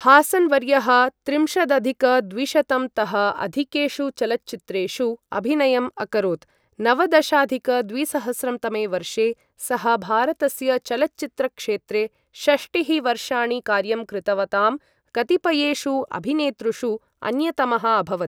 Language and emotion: Sanskrit, neutral